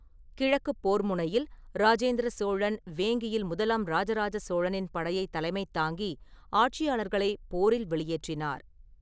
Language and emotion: Tamil, neutral